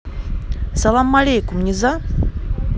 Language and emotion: Russian, neutral